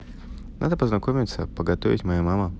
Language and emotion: Russian, neutral